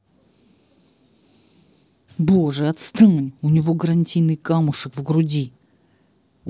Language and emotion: Russian, angry